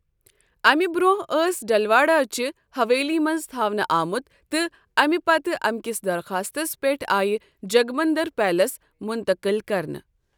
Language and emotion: Kashmiri, neutral